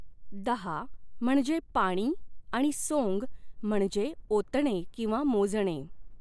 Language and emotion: Marathi, neutral